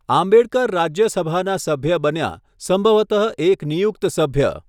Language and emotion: Gujarati, neutral